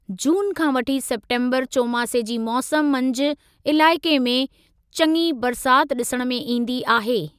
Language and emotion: Sindhi, neutral